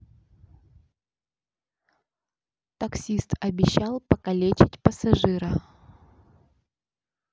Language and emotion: Russian, neutral